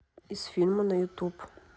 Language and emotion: Russian, neutral